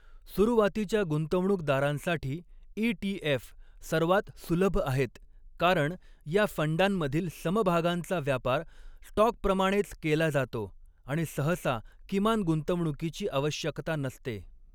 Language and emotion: Marathi, neutral